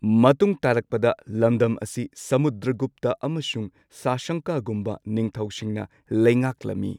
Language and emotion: Manipuri, neutral